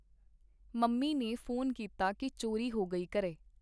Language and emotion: Punjabi, neutral